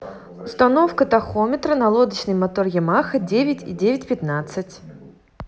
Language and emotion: Russian, neutral